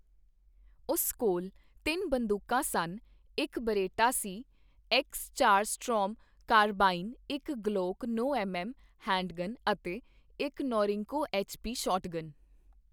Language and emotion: Punjabi, neutral